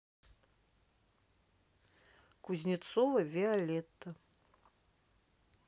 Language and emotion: Russian, neutral